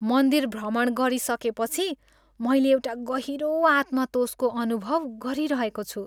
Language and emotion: Nepali, happy